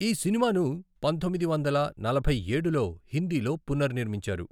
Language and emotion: Telugu, neutral